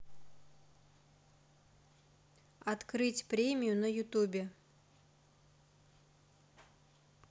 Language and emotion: Russian, neutral